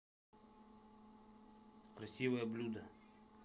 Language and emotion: Russian, neutral